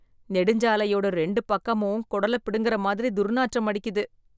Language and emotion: Tamil, disgusted